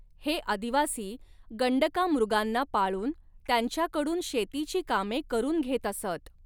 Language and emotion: Marathi, neutral